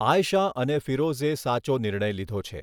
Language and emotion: Gujarati, neutral